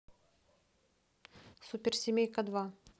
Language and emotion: Russian, neutral